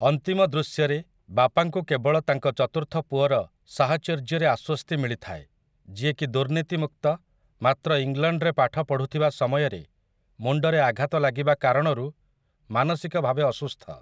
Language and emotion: Odia, neutral